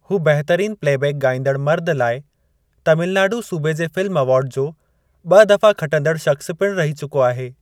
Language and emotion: Sindhi, neutral